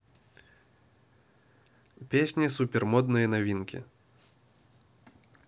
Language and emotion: Russian, neutral